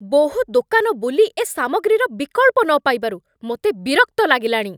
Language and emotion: Odia, angry